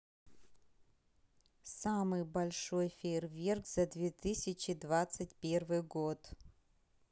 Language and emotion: Russian, neutral